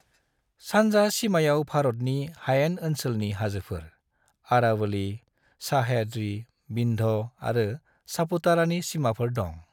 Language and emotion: Bodo, neutral